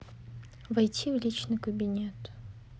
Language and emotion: Russian, neutral